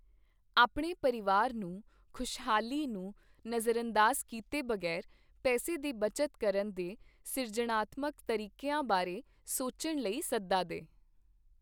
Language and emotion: Punjabi, neutral